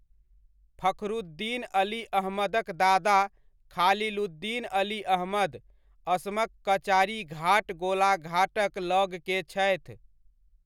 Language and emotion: Maithili, neutral